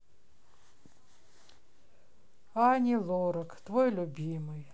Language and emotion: Russian, sad